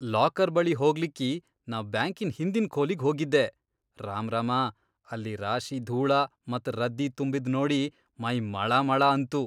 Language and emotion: Kannada, disgusted